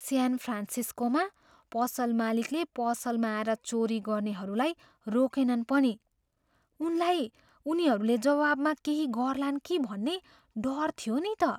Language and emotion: Nepali, fearful